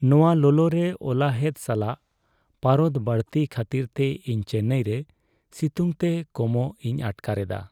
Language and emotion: Santali, sad